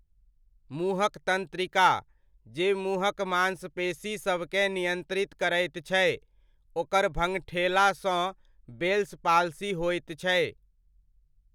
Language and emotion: Maithili, neutral